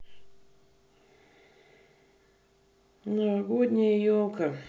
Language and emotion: Russian, neutral